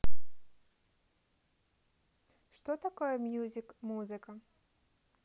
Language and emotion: Russian, neutral